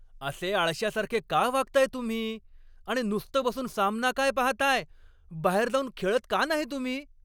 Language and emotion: Marathi, angry